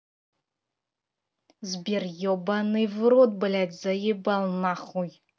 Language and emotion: Russian, angry